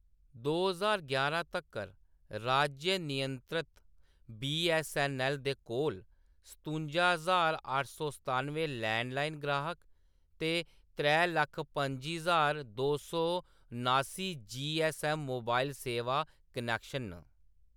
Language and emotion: Dogri, neutral